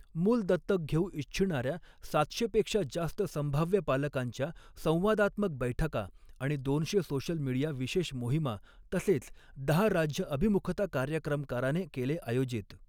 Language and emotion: Marathi, neutral